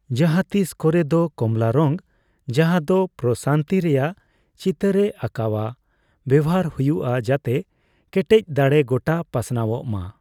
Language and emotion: Santali, neutral